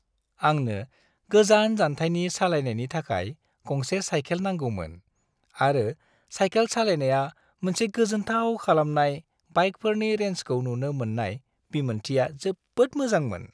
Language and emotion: Bodo, happy